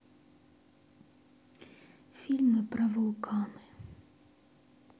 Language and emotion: Russian, sad